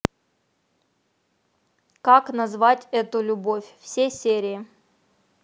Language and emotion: Russian, neutral